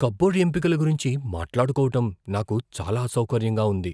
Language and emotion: Telugu, fearful